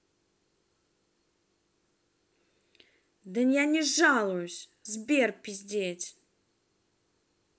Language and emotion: Russian, angry